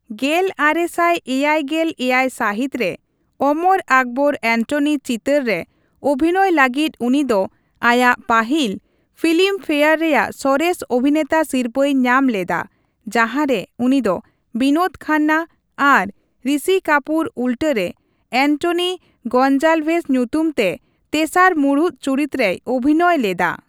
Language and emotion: Santali, neutral